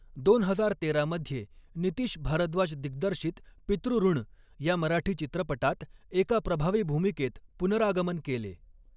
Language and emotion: Marathi, neutral